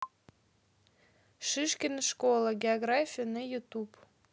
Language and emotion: Russian, neutral